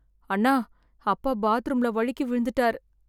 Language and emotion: Tamil, sad